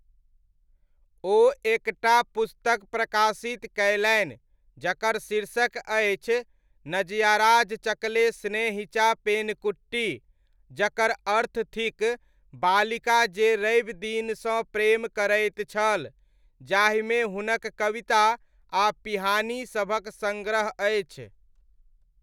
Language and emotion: Maithili, neutral